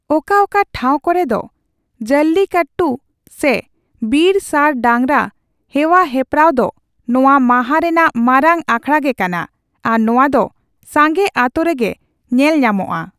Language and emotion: Santali, neutral